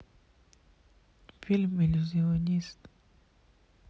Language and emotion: Russian, sad